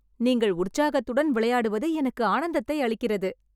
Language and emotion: Tamil, happy